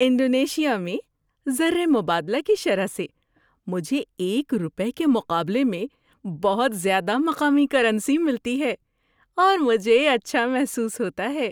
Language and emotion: Urdu, happy